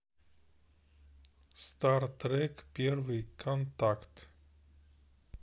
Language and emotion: Russian, neutral